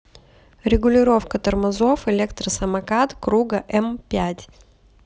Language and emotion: Russian, neutral